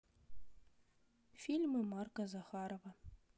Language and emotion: Russian, neutral